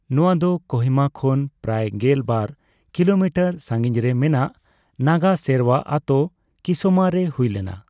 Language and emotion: Santali, neutral